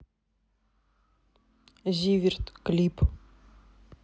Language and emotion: Russian, neutral